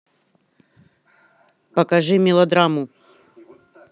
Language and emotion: Russian, angry